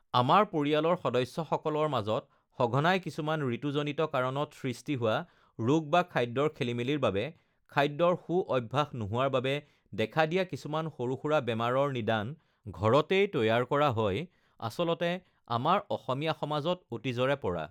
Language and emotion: Assamese, neutral